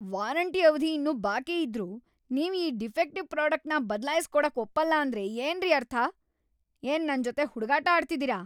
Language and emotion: Kannada, angry